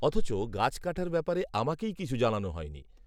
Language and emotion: Bengali, neutral